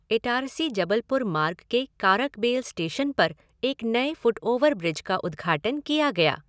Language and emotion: Hindi, neutral